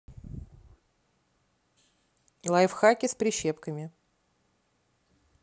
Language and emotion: Russian, neutral